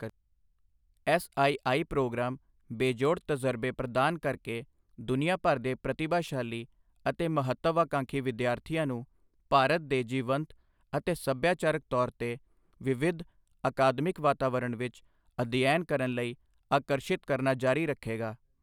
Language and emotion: Punjabi, neutral